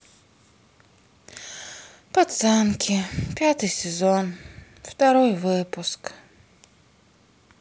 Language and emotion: Russian, sad